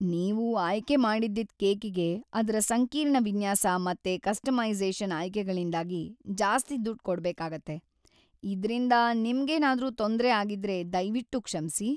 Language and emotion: Kannada, sad